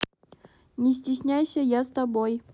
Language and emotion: Russian, neutral